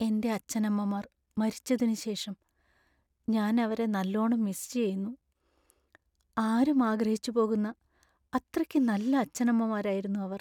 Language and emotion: Malayalam, sad